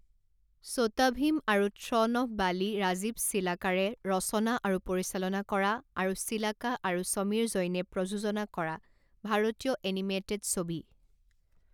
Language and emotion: Assamese, neutral